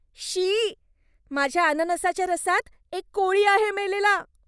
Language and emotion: Marathi, disgusted